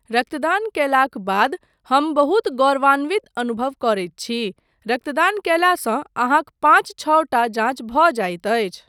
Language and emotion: Maithili, neutral